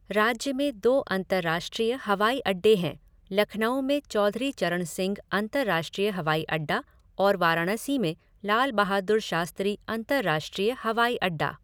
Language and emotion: Hindi, neutral